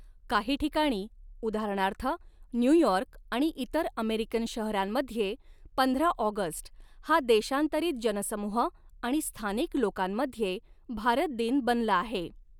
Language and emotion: Marathi, neutral